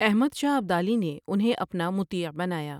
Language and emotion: Urdu, neutral